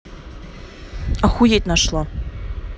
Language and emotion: Russian, angry